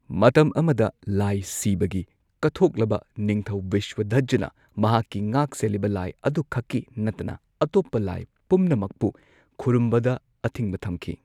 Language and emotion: Manipuri, neutral